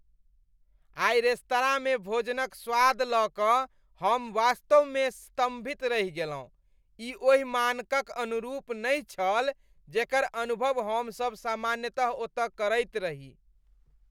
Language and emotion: Maithili, disgusted